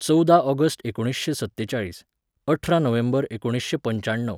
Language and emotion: Goan Konkani, neutral